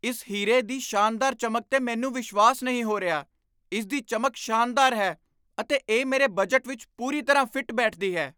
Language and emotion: Punjabi, surprised